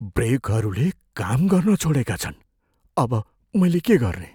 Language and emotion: Nepali, fearful